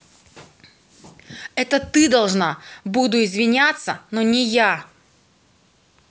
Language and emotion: Russian, angry